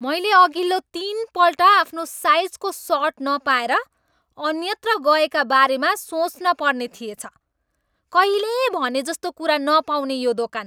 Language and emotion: Nepali, angry